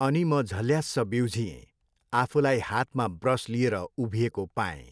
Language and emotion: Nepali, neutral